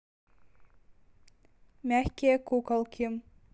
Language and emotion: Russian, neutral